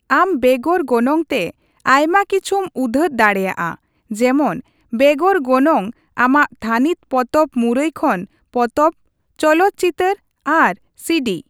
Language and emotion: Santali, neutral